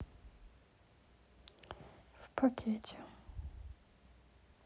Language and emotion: Russian, sad